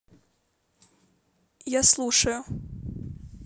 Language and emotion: Russian, neutral